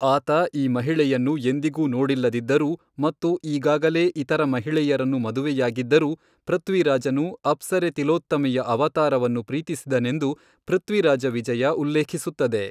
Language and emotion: Kannada, neutral